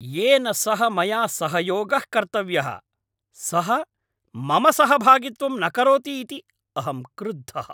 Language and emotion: Sanskrit, angry